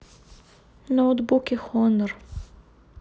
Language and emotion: Russian, sad